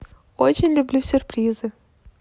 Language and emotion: Russian, positive